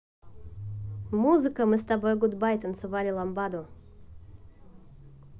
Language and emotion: Russian, positive